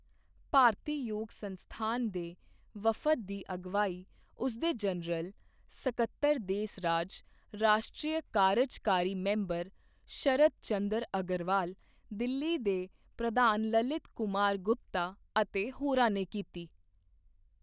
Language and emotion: Punjabi, neutral